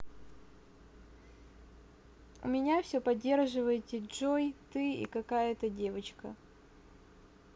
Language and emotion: Russian, neutral